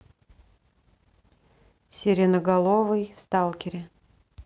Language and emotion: Russian, neutral